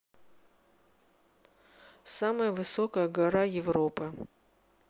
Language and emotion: Russian, neutral